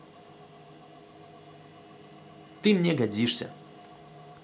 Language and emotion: Russian, positive